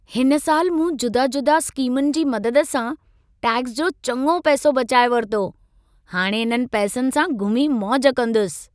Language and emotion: Sindhi, happy